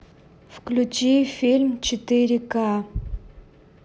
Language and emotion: Russian, neutral